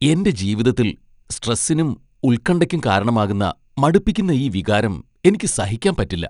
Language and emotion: Malayalam, disgusted